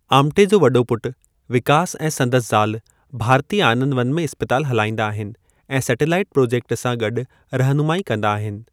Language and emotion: Sindhi, neutral